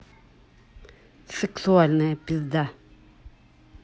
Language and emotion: Russian, angry